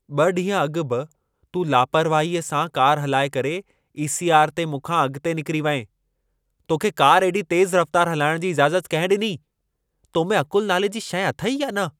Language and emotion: Sindhi, angry